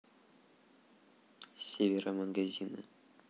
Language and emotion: Russian, neutral